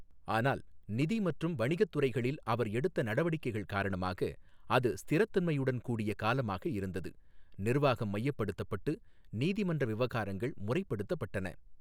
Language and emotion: Tamil, neutral